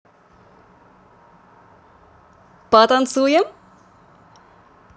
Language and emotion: Russian, positive